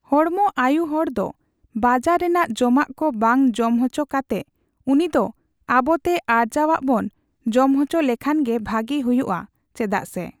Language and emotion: Santali, neutral